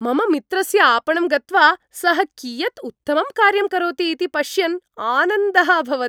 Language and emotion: Sanskrit, happy